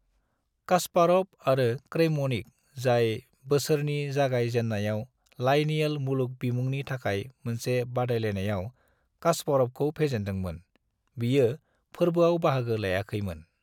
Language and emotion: Bodo, neutral